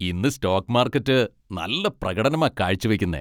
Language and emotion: Malayalam, happy